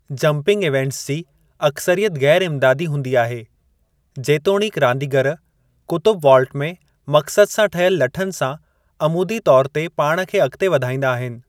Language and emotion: Sindhi, neutral